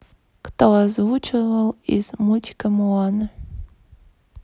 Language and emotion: Russian, neutral